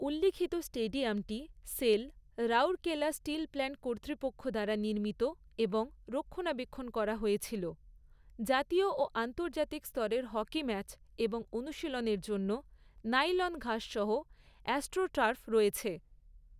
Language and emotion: Bengali, neutral